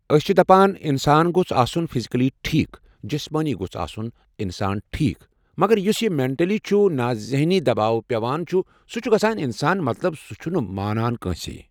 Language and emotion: Kashmiri, neutral